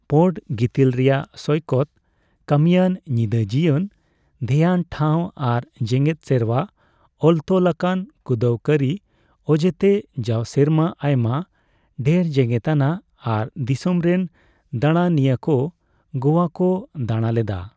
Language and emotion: Santali, neutral